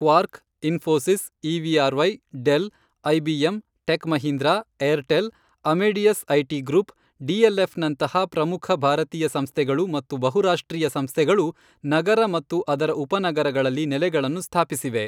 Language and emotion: Kannada, neutral